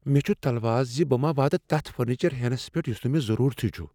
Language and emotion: Kashmiri, fearful